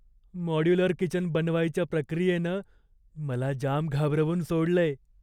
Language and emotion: Marathi, fearful